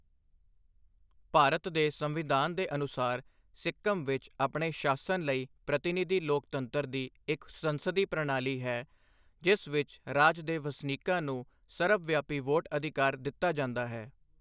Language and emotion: Punjabi, neutral